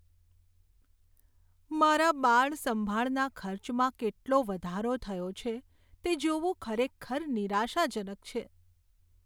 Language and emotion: Gujarati, sad